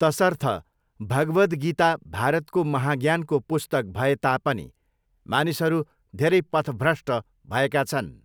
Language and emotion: Nepali, neutral